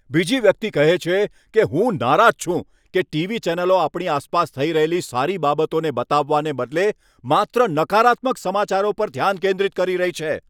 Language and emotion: Gujarati, angry